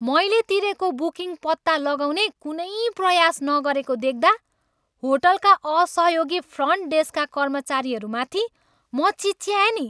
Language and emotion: Nepali, angry